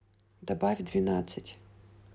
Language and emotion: Russian, neutral